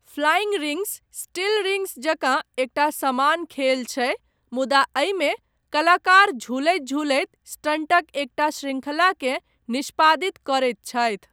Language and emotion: Maithili, neutral